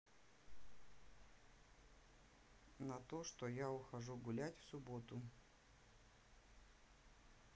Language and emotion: Russian, neutral